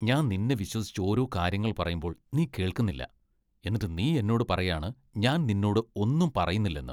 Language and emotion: Malayalam, disgusted